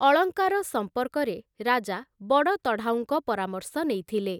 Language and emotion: Odia, neutral